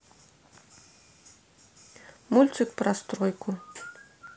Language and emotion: Russian, neutral